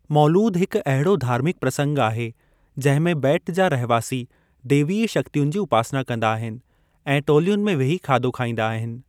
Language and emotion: Sindhi, neutral